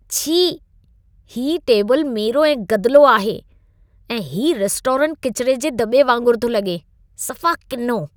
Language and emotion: Sindhi, disgusted